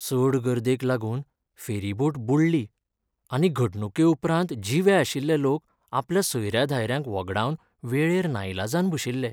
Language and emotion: Goan Konkani, sad